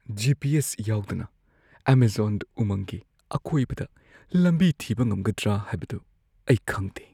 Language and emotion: Manipuri, fearful